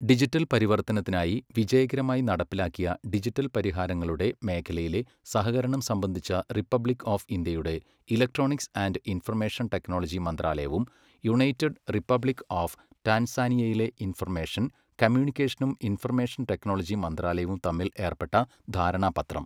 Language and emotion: Malayalam, neutral